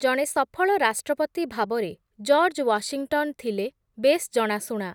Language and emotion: Odia, neutral